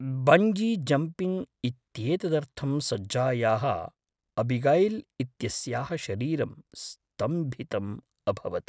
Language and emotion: Sanskrit, fearful